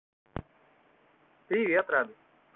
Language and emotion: Russian, positive